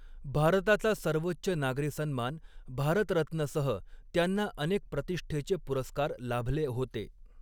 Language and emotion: Marathi, neutral